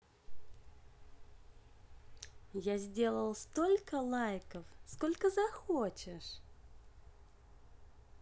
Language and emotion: Russian, positive